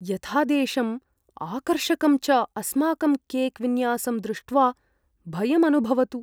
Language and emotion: Sanskrit, fearful